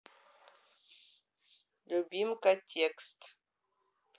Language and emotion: Russian, neutral